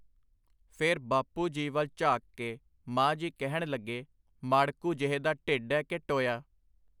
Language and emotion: Punjabi, neutral